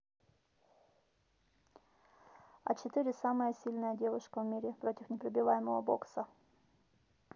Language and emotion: Russian, neutral